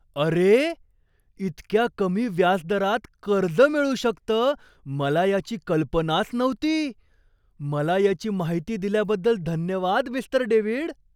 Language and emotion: Marathi, surprised